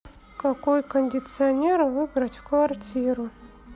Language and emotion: Russian, neutral